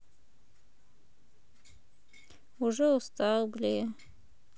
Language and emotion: Russian, sad